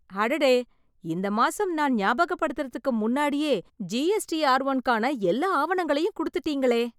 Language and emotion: Tamil, surprised